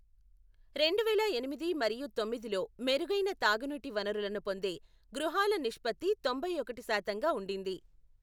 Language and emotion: Telugu, neutral